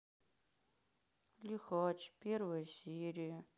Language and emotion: Russian, sad